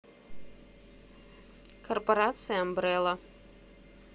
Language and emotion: Russian, neutral